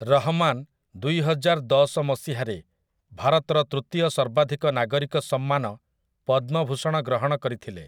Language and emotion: Odia, neutral